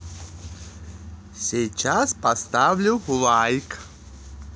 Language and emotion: Russian, positive